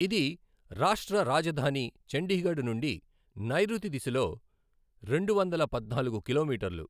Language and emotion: Telugu, neutral